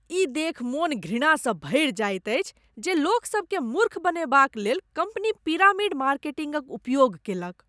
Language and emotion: Maithili, disgusted